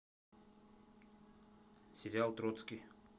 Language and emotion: Russian, neutral